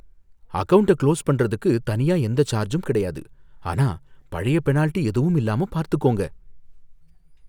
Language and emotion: Tamil, fearful